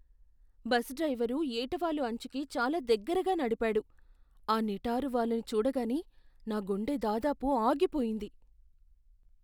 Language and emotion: Telugu, fearful